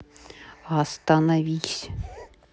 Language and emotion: Russian, neutral